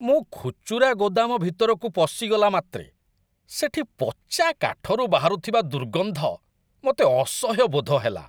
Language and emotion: Odia, disgusted